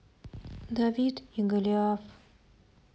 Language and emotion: Russian, sad